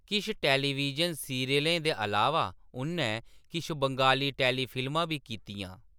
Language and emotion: Dogri, neutral